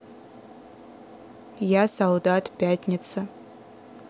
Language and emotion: Russian, neutral